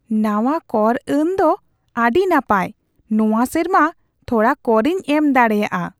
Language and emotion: Santali, surprised